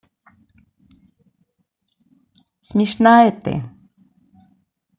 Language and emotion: Russian, positive